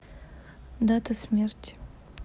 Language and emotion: Russian, neutral